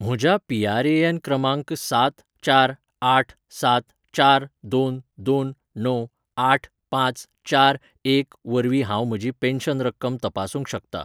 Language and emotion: Goan Konkani, neutral